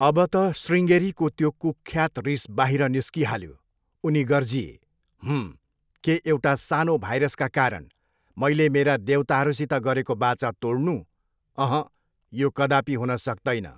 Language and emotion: Nepali, neutral